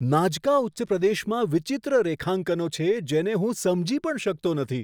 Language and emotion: Gujarati, surprised